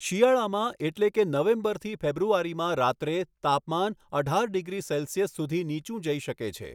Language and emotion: Gujarati, neutral